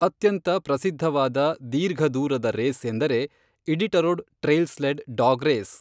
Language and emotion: Kannada, neutral